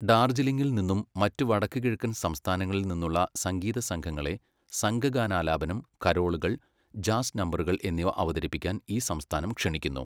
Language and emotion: Malayalam, neutral